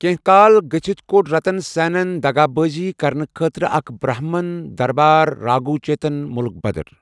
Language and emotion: Kashmiri, neutral